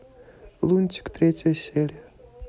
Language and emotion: Russian, neutral